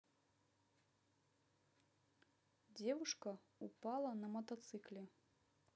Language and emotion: Russian, neutral